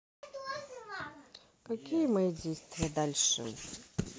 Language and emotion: Russian, neutral